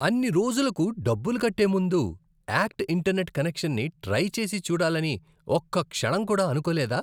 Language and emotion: Telugu, disgusted